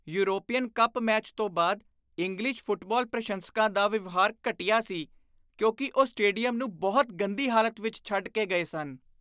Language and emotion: Punjabi, disgusted